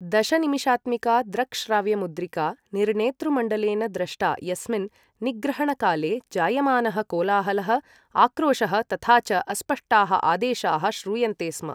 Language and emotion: Sanskrit, neutral